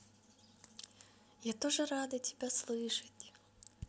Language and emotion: Russian, positive